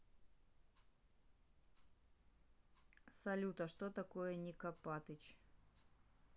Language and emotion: Russian, neutral